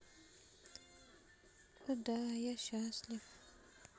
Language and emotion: Russian, sad